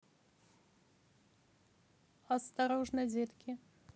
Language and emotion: Russian, neutral